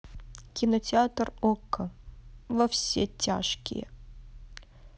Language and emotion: Russian, neutral